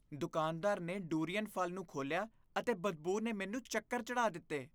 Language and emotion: Punjabi, disgusted